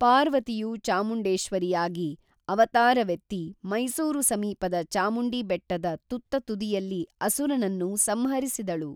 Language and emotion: Kannada, neutral